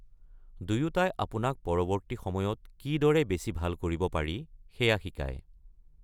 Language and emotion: Assamese, neutral